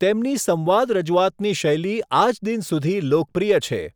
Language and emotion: Gujarati, neutral